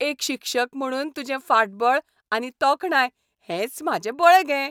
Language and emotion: Goan Konkani, happy